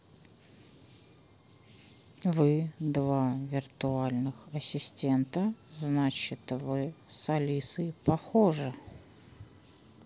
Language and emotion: Russian, neutral